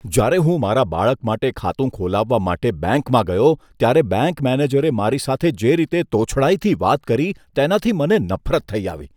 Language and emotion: Gujarati, disgusted